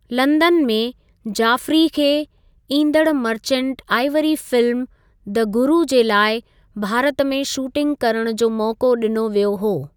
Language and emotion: Sindhi, neutral